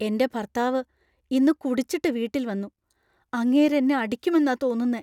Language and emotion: Malayalam, fearful